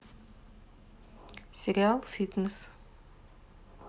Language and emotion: Russian, neutral